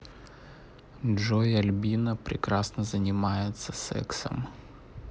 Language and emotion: Russian, neutral